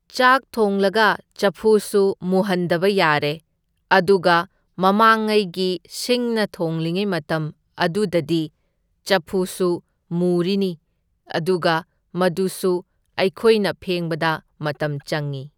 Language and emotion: Manipuri, neutral